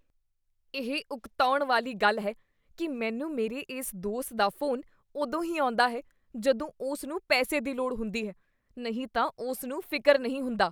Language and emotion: Punjabi, disgusted